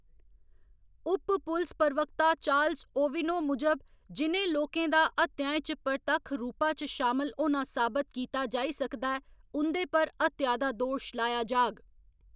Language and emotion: Dogri, neutral